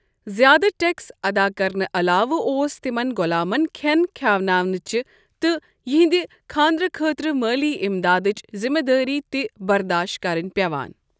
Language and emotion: Kashmiri, neutral